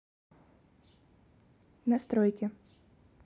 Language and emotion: Russian, neutral